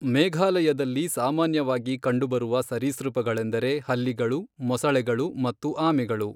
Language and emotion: Kannada, neutral